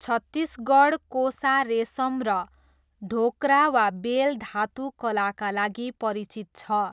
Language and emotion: Nepali, neutral